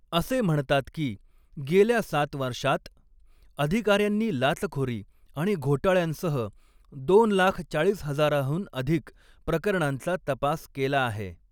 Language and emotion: Marathi, neutral